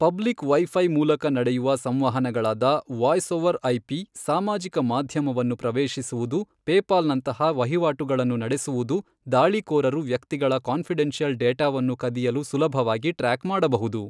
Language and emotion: Kannada, neutral